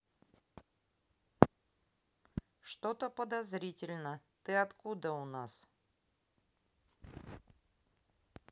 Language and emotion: Russian, neutral